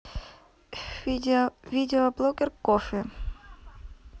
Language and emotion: Russian, neutral